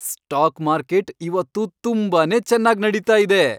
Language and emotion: Kannada, happy